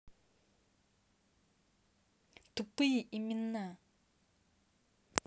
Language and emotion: Russian, angry